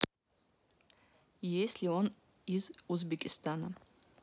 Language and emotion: Russian, neutral